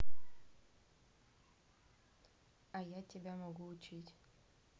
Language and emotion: Russian, neutral